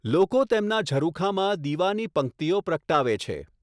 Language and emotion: Gujarati, neutral